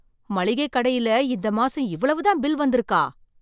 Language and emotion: Tamil, surprised